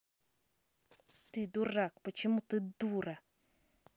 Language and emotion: Russian, angry